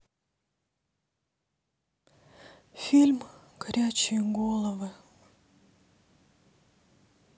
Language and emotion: Russian, sad